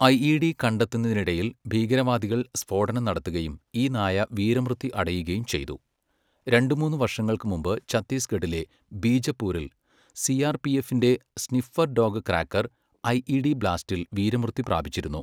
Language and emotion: Malayalam, neutral